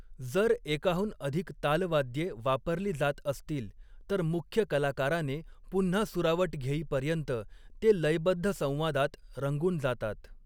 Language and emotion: Marathi, neutral